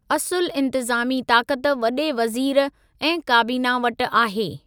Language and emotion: Sindhi, neutral